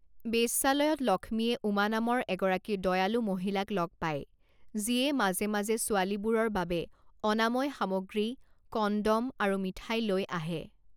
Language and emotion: Assamese, neutral